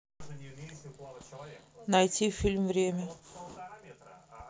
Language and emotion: Russian, neutral